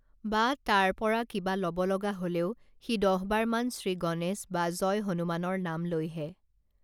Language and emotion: Assamese, neutral